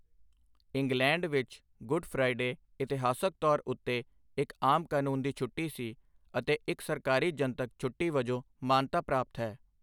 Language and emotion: Punjabi, neutral